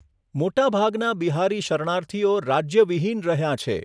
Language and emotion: Gujarati, neutral